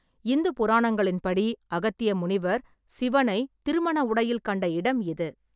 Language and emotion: Tamil, neutral